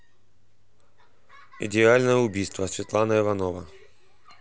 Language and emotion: Russian, neutral